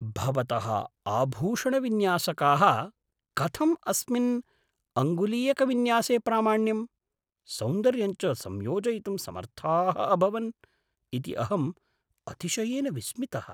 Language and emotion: Sanskrit, surprised